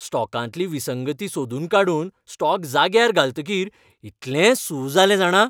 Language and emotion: Goan Konkani, happy